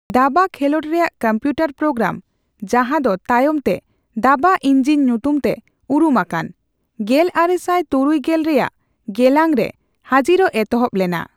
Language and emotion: Santali, neutral